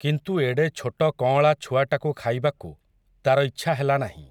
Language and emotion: Odia, neutral